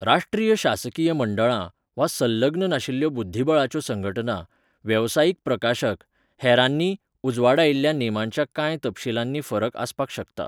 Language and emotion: Goan Konkani, neutral